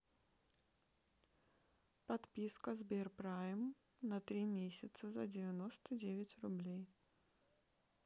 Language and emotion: Russian, neutral